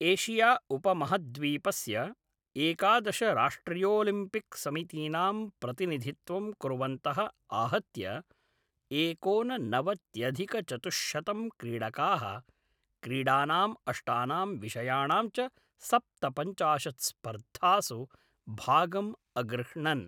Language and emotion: Sanskrit, neutral